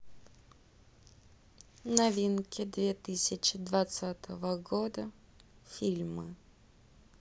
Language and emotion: Russian, neutral